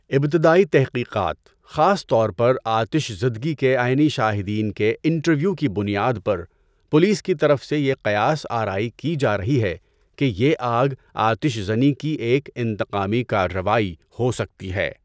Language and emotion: Urdu, neutral